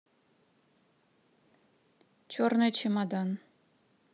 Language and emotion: Russian, neutral